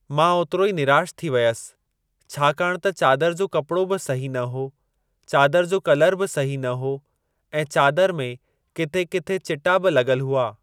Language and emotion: Sindhi, neutral